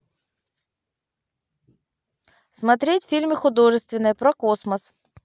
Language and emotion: Russian, neutral